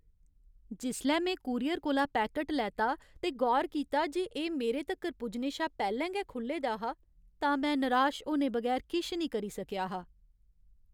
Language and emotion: Dogri, sad